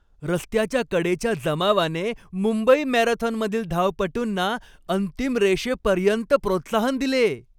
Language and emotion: Marathi, happy